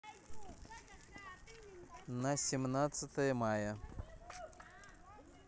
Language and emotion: Russian, neutral